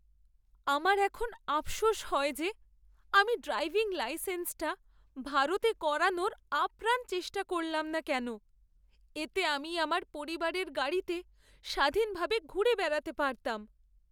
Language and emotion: Bengali, sad